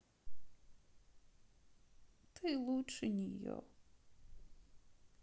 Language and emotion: Russian, sad